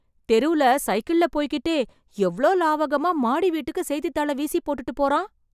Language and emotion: Tamil, surprised